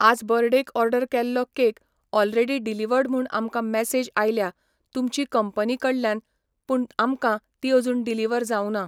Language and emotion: Goan Konkani, neutral